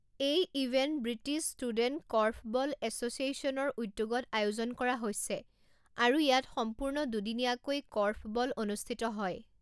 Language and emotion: Assamese, neutral